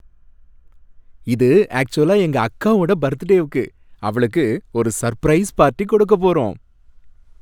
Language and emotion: Tamil, happy